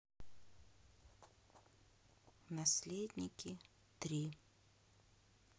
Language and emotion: Russian, neutral